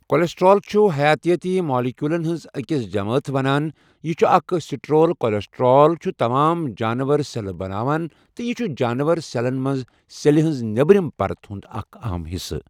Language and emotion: Kashmiri, neutral